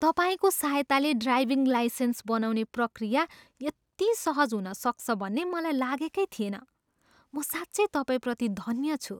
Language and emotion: Nepali, surprised